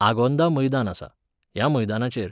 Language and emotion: Goan Konkani, neutral